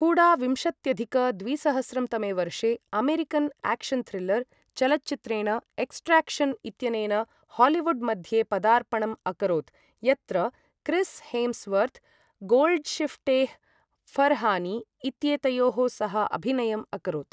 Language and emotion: Sanskrit, neutral